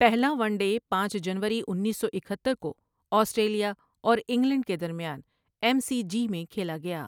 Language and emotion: Urdu, neutral